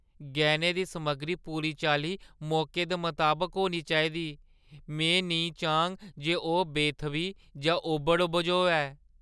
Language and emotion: Dogri, fearful